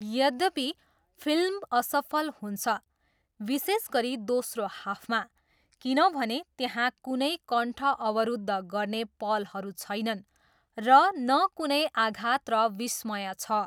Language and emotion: Nepali, neutral